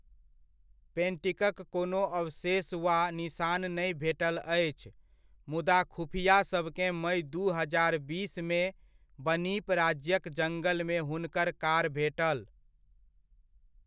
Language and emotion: Maithili, neutral